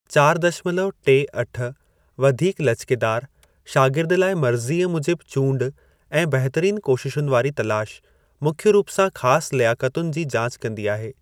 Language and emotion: Sindhi, neutral